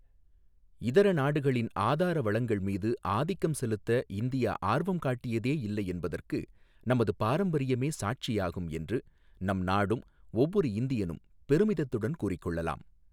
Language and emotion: Tamil, neutral